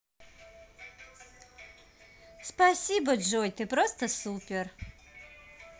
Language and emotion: Russian, positive